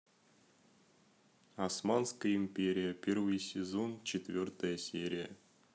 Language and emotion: Russian, neutral